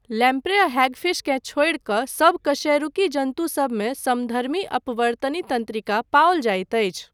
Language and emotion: Maithili, neutral